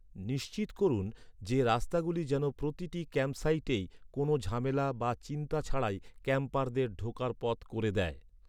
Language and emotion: Bengali, neutral